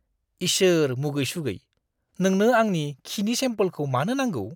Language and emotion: Bodo, disgusted